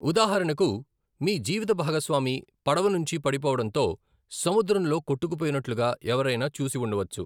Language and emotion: Telugu, neutral